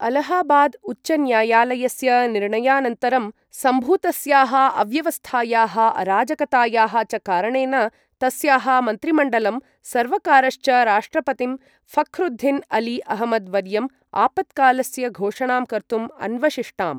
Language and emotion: Sanskrit, neutral